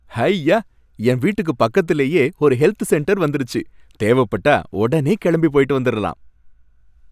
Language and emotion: Tamil, happy